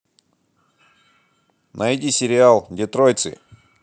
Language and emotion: Russian, positive